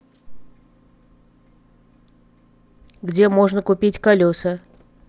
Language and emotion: Russian, neutral